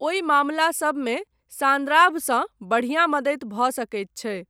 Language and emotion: Maithili, neutral